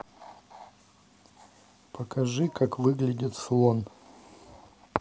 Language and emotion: Russian, neutral